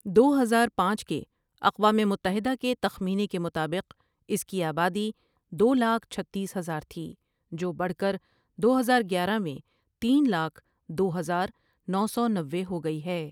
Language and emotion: Urdu, neutral